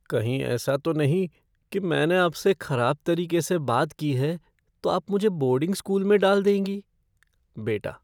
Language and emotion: Hindi, fearful